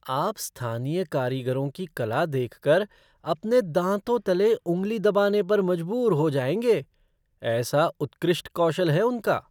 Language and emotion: Hindi, surprised